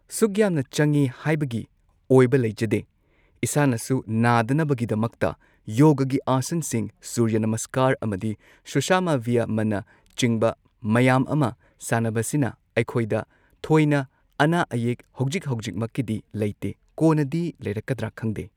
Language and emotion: Manipuri, neutral